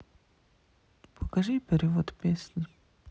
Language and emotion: Russian, neutral